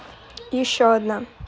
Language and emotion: Russian, neutral